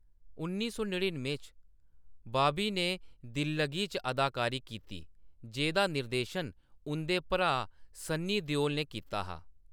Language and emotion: Dogri, neutral